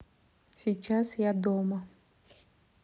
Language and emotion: Russian, neutral